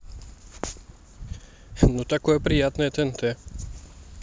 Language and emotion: Russian, neutral